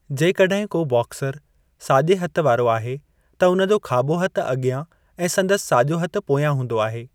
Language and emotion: Sindhi, neutral